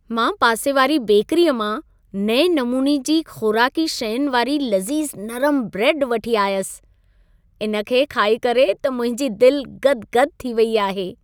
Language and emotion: Sindhi, happy